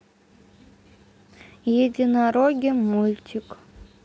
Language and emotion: Russian, neutral